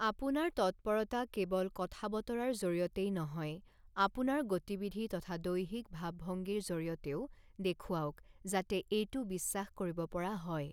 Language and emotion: Assamese, neutral